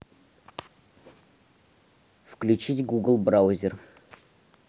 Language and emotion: Russian, neutral